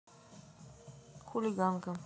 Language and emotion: Russian, neutral